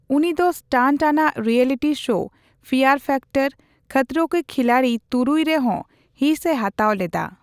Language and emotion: Santali, neutral